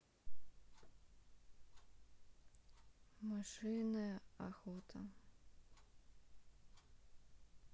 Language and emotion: Russian, sad